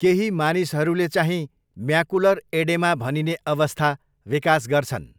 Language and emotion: Nepali, neutral